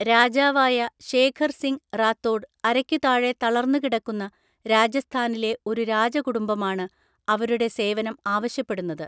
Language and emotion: Malayalam, neutral